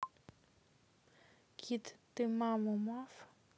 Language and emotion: Russian, neutral